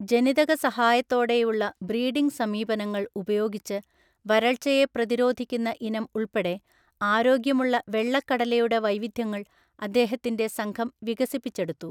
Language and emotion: Malayalam, neutral